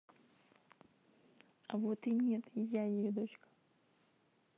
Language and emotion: Russian, neutral